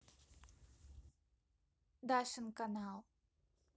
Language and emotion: Russian, neutral